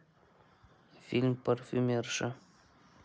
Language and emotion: Russian, neutral